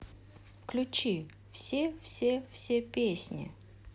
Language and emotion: Russian, neutral